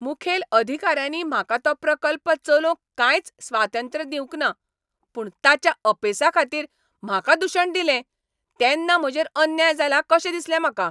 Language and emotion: Goan Konkani, angry